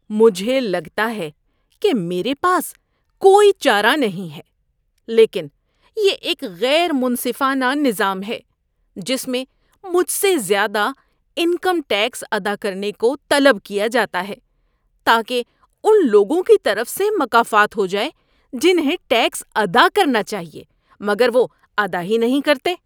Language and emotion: Urdu, disgusted